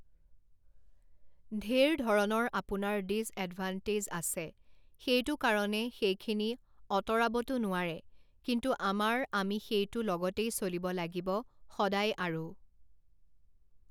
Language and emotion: Assamese, neutral